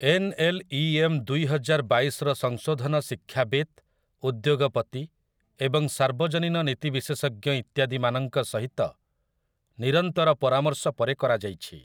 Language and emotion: Odia, neutral